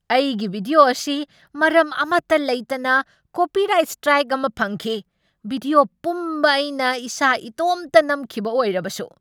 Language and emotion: Manipuri, angry